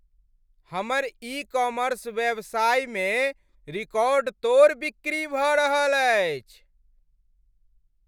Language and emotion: Maithili, happy